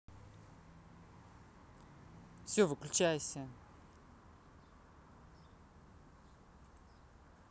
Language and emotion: Russian, angry